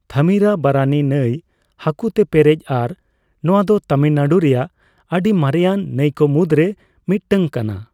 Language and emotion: Santali, neutral